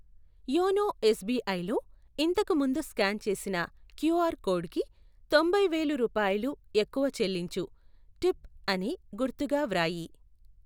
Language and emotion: Telugu, neutral